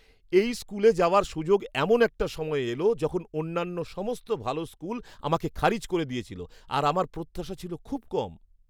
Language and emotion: Bengali, surprised